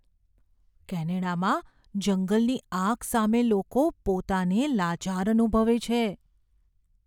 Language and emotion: Gujarati, fearful